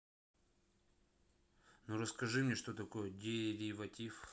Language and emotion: Russian, neutral